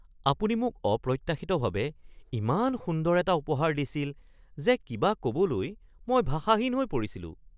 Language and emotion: Assamese, surprised